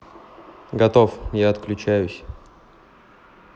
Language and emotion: Russian, neutral